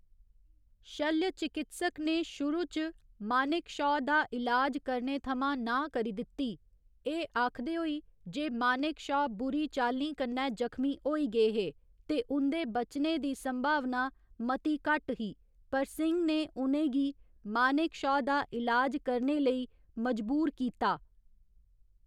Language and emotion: Dogri, neutral